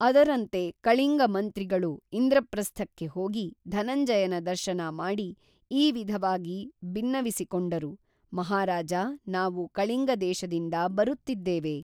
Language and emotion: Kannada, neutral